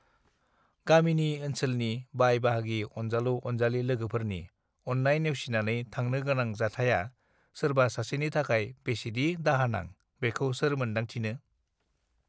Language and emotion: Bodo, neutral